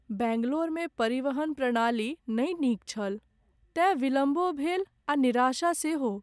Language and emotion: Maithili, sad